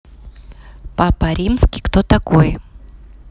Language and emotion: Russian, neutral